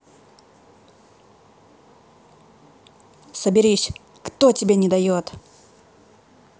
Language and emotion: Russian, angry